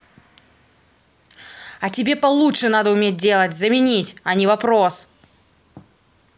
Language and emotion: Russian, angry